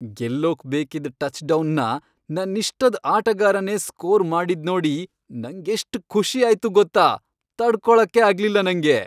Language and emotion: Kannada, happy